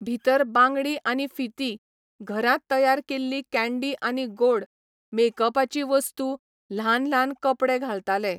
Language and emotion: Goan Konkani, neutral